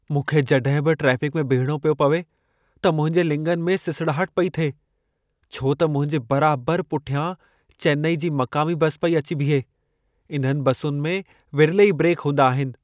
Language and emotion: Sindhi, fearful